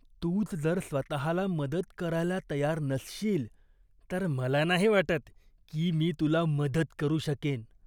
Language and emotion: Marathi, disgusted